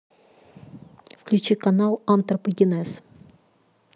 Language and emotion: Russian, neutral